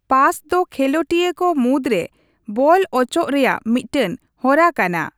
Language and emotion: Santali, neutral